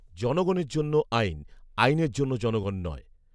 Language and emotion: Bengali, neutral